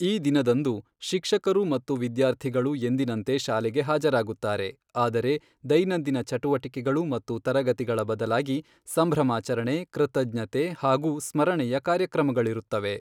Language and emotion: Kannada, neutral